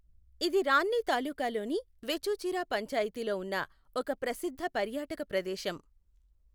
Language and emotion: Telugu, neutral